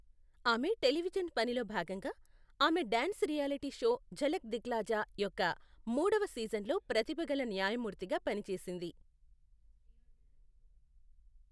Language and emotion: Telugu, neutral